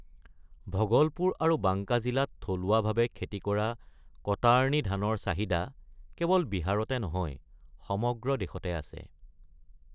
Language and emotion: Assamese, neutral